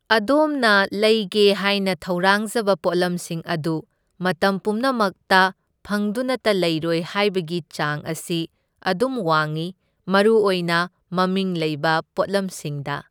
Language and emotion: Manipuri, neutral